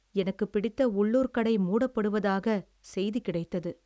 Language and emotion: Tamil, sad